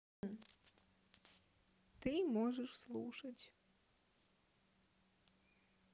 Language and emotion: Russian, neutral